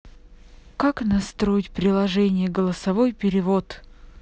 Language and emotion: Russian, neutral